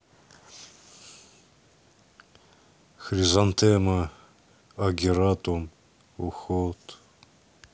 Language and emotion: Russian, neutral